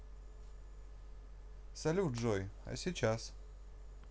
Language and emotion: Russian, positive